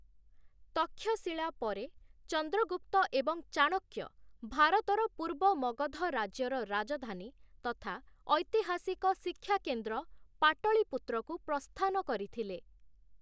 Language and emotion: Odia, neutral